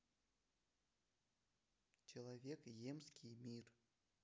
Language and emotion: Russian, neutral